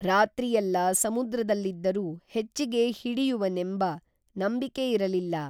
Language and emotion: Kannada, neutral